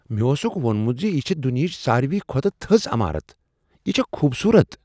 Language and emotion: Kashmiri, surprised